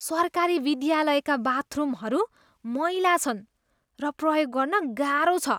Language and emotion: Nepali, disgusted